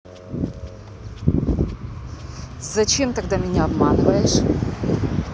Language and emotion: Russian, angry